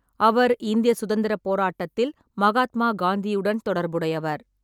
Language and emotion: Tamil, neutral